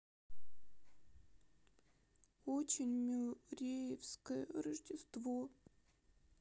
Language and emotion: Russian, sad